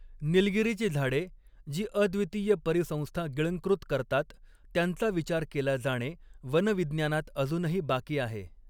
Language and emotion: Marathi, neutral